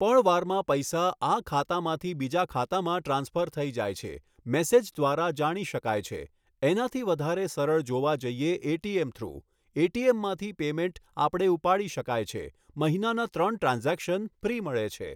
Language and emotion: Gujarati, neutral